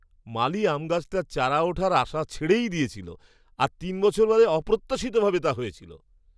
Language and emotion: Bengali, surprised